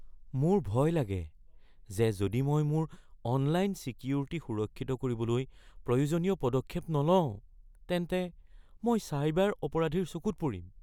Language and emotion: Assamese, fearful